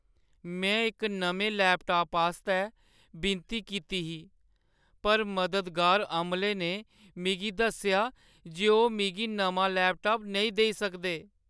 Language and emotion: Dogri, sad